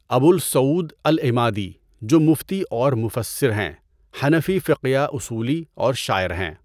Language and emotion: Urdu, neutral